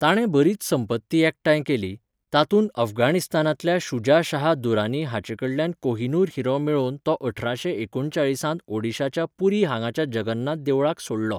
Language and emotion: Goan Konkani, neutral